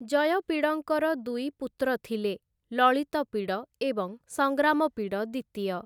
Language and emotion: Odia, neutral